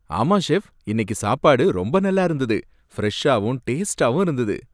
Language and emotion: Tamil, happy